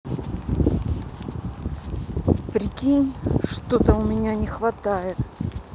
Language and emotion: Russian, angry